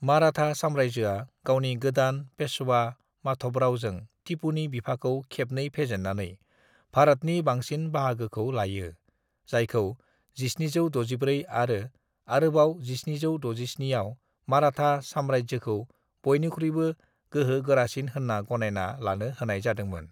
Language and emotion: Bodo, neutral